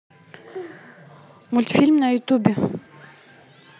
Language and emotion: Russian, neutral